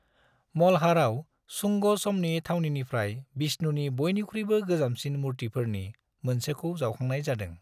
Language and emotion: Bodo, neutral